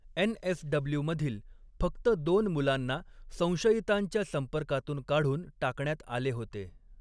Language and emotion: Marathi, neutral